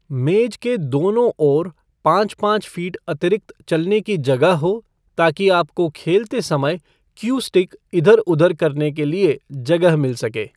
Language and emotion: Hindi, neutral